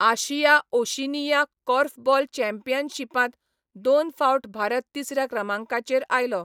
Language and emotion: Goan Konkani, neutral